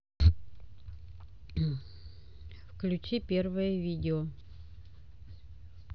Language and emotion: Russian, neutral